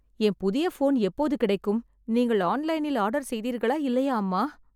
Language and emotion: Tamil, sad